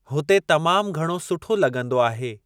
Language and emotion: Sindhi, neutral